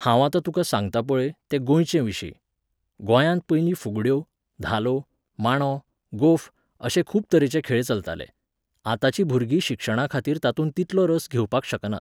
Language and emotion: Goan Konkani, neutral